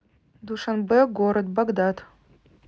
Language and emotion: Russian, neutral